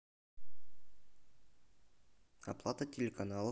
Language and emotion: Russian, neutral